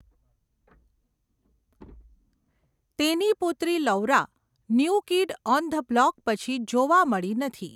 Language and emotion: Gujarati, neutral